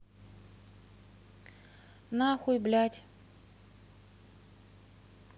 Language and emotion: Russian, neutral